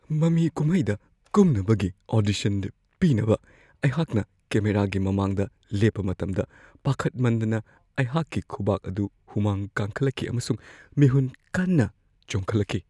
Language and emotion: Manipuri, fearful